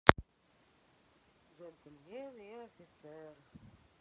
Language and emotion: Russian, sad